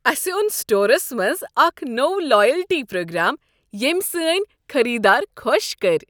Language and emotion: Kashmiri, happy